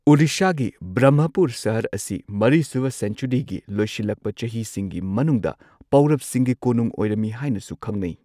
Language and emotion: Manipuri, neutral